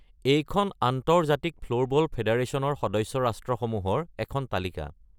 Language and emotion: Assamese, neutral